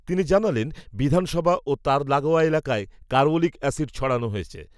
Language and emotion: Bengali, neutral